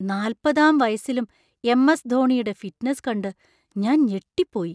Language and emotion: Malayalam, surprised